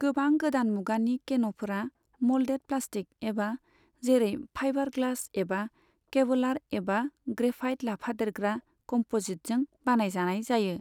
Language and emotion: Bodo, neutral